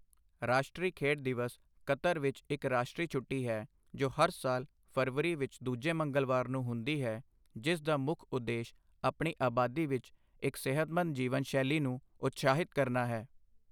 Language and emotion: Punjabi, neutral